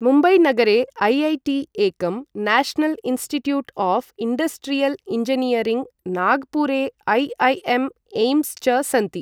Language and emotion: Sanskrit, neutral